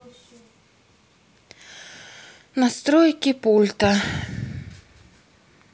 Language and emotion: Russian, sad